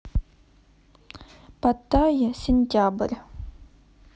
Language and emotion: Russian, neutral